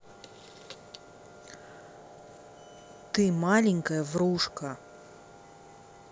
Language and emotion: Russian, neutral